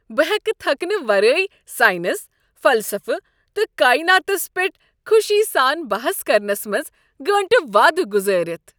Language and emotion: Kashmiri, happy